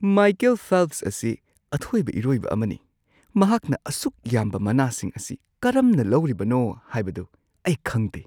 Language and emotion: Manipuri, surprised